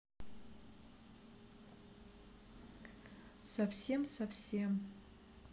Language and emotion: Russian, neutral